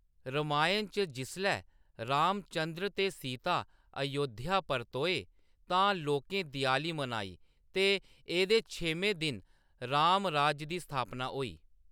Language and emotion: Dogri, neutral